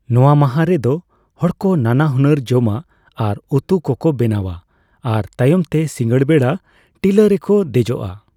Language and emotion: Santali, neutral